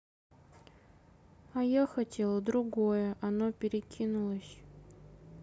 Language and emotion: Russian, sad